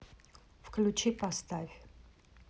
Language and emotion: Russian, neutral